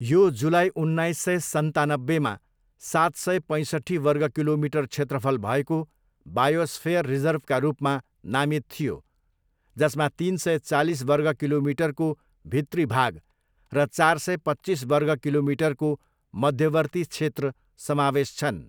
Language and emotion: Nepali, neutral